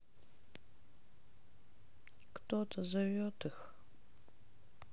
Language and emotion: Russian, sad